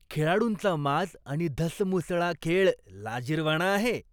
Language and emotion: Marathi, disgusted